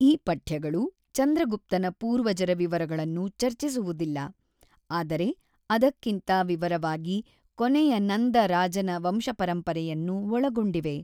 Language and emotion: Kannada, neutral